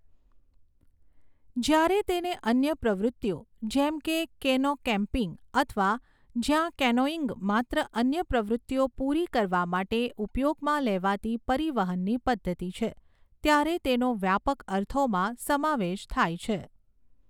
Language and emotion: Gujarati, neutral